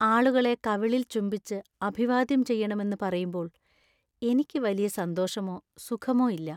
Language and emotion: Malayalam, sad